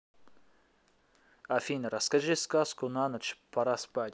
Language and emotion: Russian, neutral